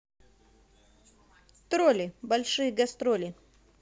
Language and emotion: Russian, positive